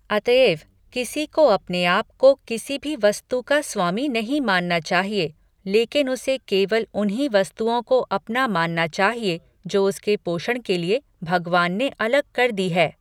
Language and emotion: Hindi, neutral